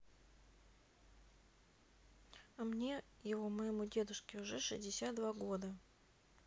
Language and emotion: Russian, neutral